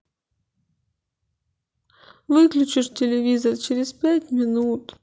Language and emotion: Russian, sad